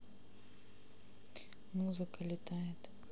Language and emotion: Russian, neutral